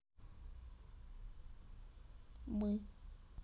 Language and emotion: Russian, neutral